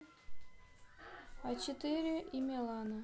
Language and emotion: Russian, neutral